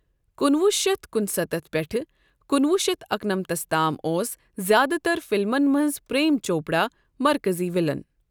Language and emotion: Kashmiri, neutral